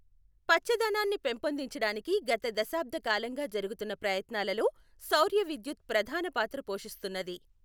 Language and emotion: Telugu, neutral